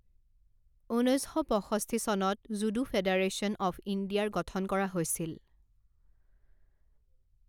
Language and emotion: Assamese, neutral